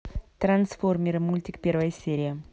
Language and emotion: Russian, neutral